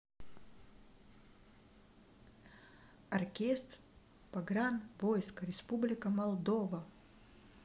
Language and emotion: Russian, neutral